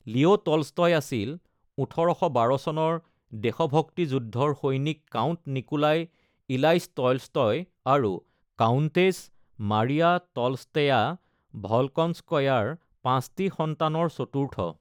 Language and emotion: Assamese, neutral